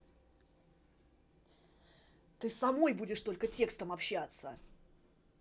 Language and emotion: Russian, angry